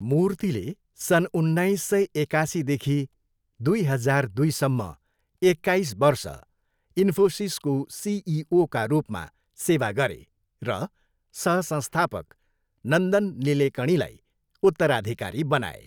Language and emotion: Nepali, neutral